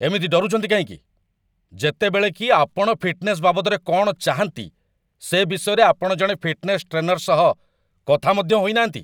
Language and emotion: Odia, angry